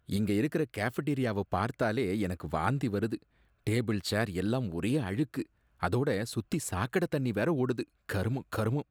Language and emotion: Tamil, disgusted